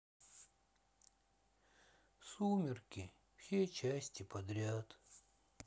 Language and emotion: Russian, sad